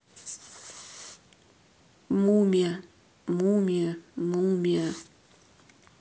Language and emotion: Russian, neutral